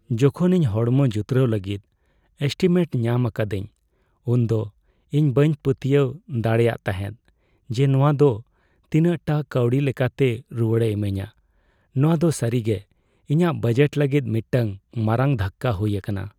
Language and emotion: Santali, sad